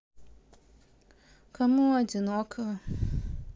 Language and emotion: Russian, sad